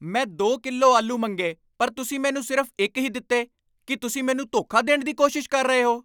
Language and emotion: Punjabi, angry